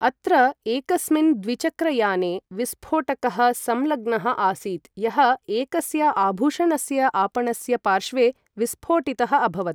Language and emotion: Sanskrit, neutral